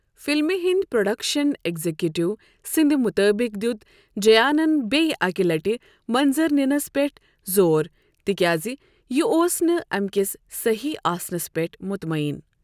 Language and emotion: Kashmiri, neutral